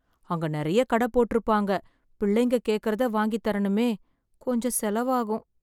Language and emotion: Tamil, sad